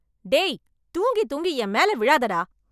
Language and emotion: Tamil, angry